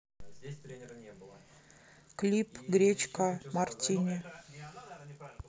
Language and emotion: Russian, neutral